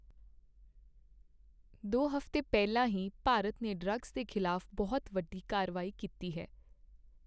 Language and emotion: Punjabi, neutral